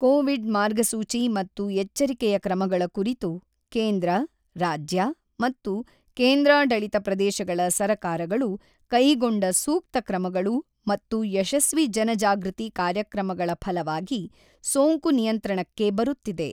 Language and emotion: Kannada, neutral